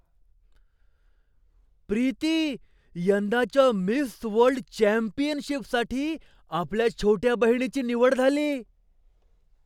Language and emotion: Marathi, surprised